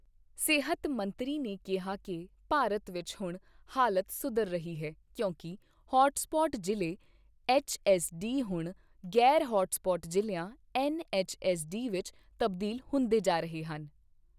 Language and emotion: Punjabi, neutral